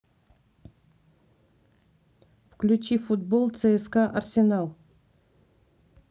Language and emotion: Russian, neutral